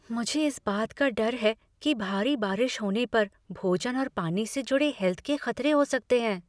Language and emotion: Hindi, fearful